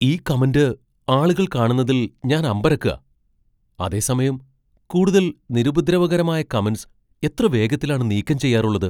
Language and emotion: Malayalam, surprised